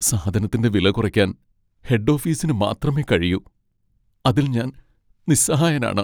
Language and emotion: Malayalam, sad